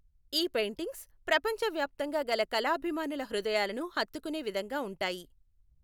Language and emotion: Telugu, neutral